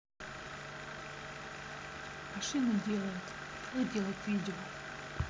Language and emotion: Russian, neutral